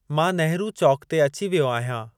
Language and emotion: Sindhi, neutral